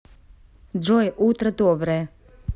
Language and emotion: Russian, neutral